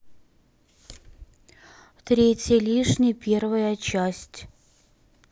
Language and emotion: Russian, neutral